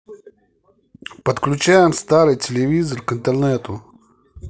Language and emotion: Russian, neutral